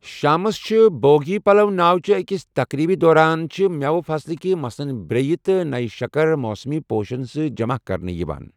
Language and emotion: Kashmiri, neutral